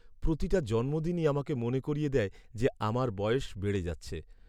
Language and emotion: Bengali, sad